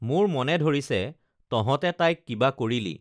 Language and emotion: Assamese, neutral